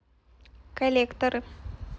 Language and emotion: Russian, neutral